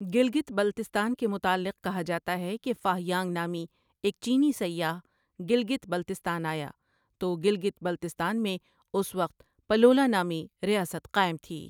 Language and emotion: Urdu, neutral